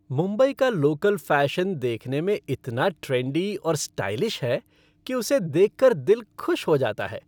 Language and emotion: Hindi, happy